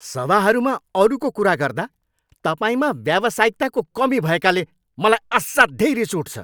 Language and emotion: Nepali, angry